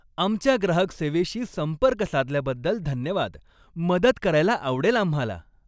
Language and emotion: Marathi, happy